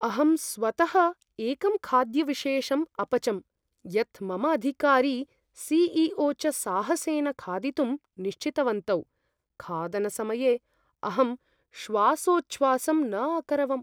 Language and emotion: Sanskrit, fearful